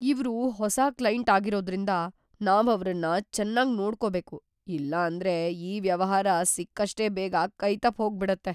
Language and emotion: Kannada, fearful